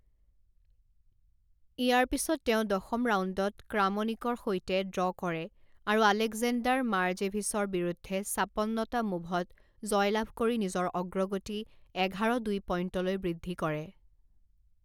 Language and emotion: Assamese, neutral